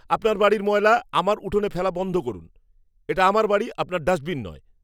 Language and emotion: Bengali, angry